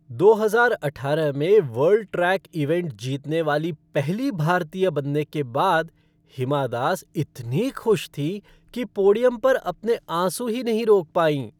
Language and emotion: Hindi, happy